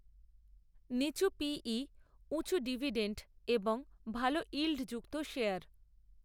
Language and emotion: Bengali, neutral